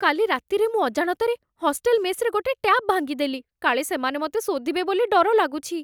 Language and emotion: Odia, fearful